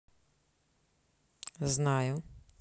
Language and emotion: Russian, neutral